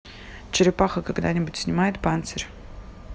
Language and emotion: Russian, neutral